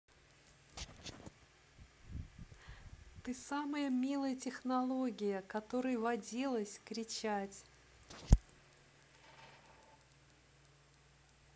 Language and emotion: Russian, positive